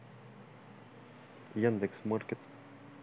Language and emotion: Russian, neutral